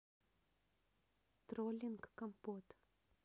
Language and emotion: Russian, neutral